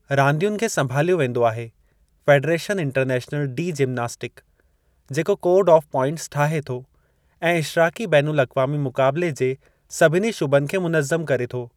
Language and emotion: Sindhi, neutral